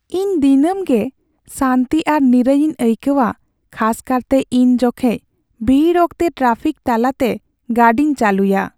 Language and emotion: Santali, sad